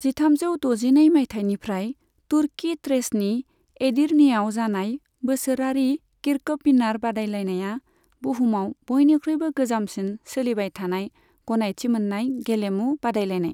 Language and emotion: Bodo, neutral